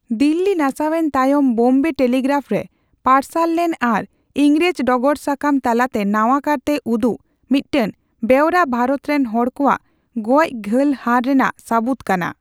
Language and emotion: Santali, neutral